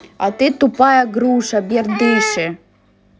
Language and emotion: Russian, angry